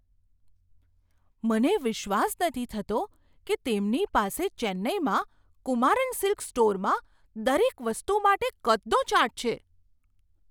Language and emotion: Gujarati, surprised